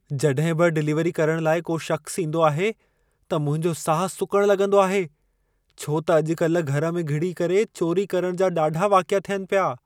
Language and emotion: Sindhi, fearful